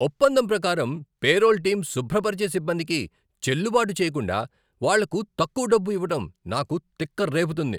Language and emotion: Telugu, angry